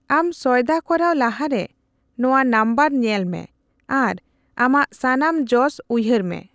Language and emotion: Santali, neutral